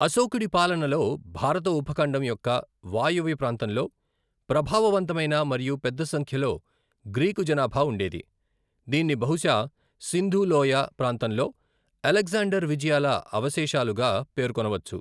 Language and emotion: Telugu, neutral